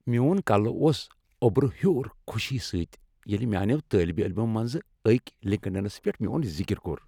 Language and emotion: Kashmiri, happy